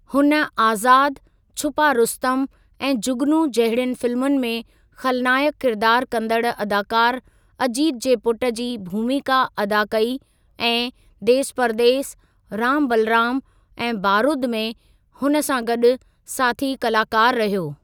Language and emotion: Sindhi, neutral